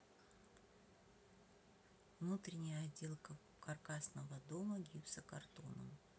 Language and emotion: Russian, neutral